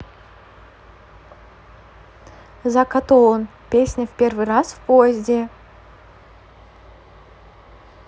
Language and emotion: Russian, neutral